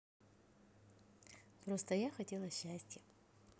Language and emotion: Russian, positive